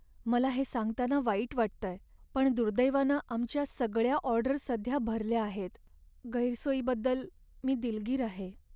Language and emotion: Marathi, sad